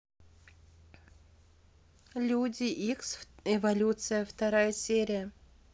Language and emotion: Russian, neutral